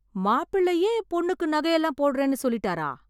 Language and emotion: Tamil, surprised